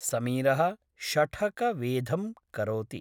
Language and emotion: Sanskrit, neutral